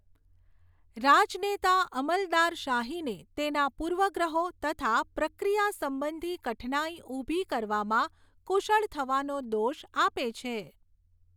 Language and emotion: Gujarati, neutral